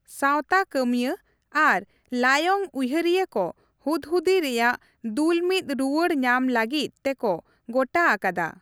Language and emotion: Santali, neutral